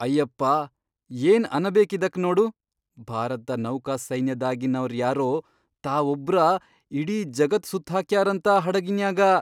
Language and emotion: Kannada, surprised